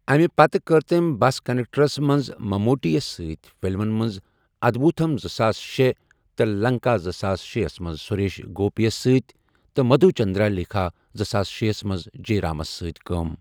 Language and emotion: Kashmiri, neutral